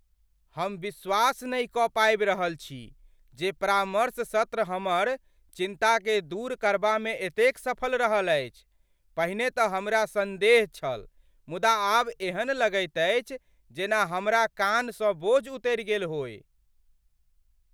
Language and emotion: Maithili, surprised